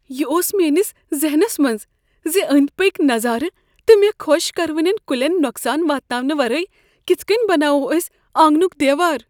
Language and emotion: Kashmiri, fearful